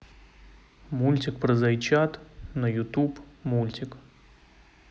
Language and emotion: Russian, neutral